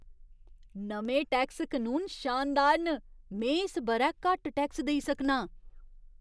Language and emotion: Dogri, surprised